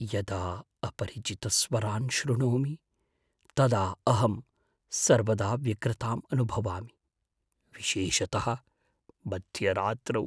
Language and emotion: Sanskrit, fearful